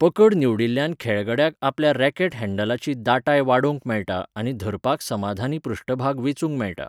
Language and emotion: Goan Konkani, neutral